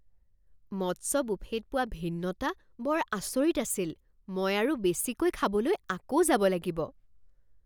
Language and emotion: Assamese, surprised